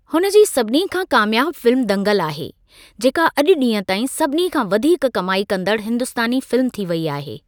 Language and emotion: Sindhi, neutral